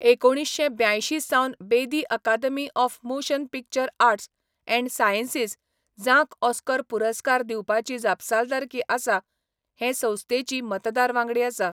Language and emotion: Goan Konkani, neutral